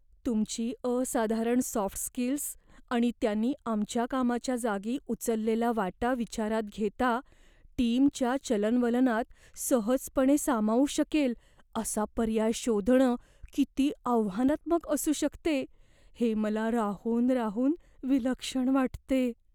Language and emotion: Marathi, fearful